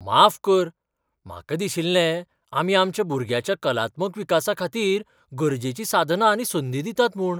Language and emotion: Goan Konkani, surprised